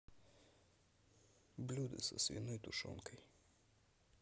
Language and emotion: Russian, neutral